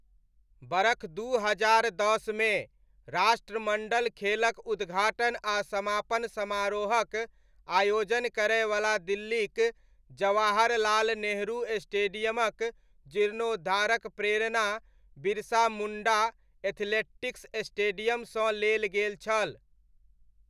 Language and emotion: Maithili, neutral